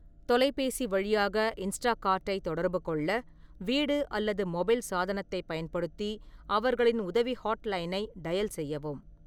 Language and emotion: Tamil, neutral